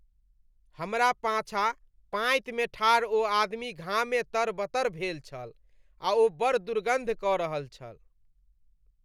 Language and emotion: Maithili, disgusted